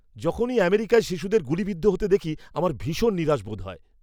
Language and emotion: Bengali, angry